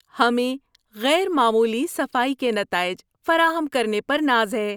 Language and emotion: Urdu, happy